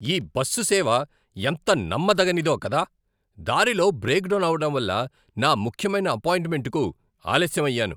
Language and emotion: Telugu, angry